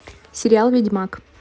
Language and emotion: Russian, neutral